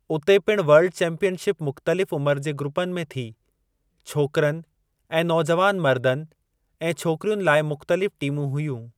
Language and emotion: Sindhi, neutral